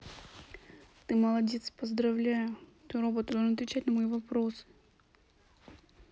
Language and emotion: Russian, neutral